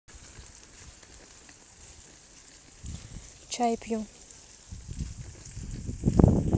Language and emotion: Russian, neutral